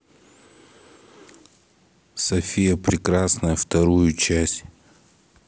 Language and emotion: Russian, neutral